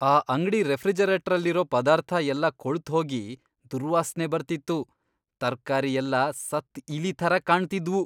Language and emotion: Kannada, disgusted